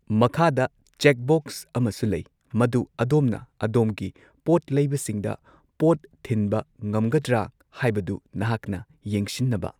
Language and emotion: Manipuri, neutral